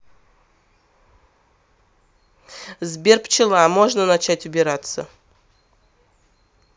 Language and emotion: Russian, neutral